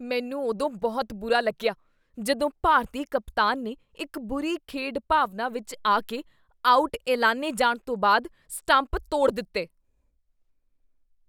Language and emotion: Punjabi, disgusted